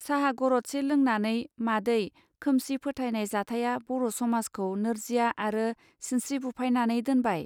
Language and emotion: Bodo, neutral